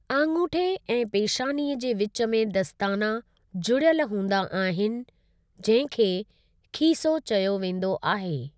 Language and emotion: Sindhi, neutral